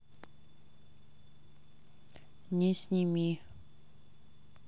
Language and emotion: Russian, neutral